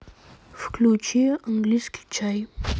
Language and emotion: Russian, neutral